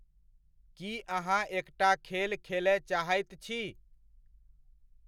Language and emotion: Maithili, neutral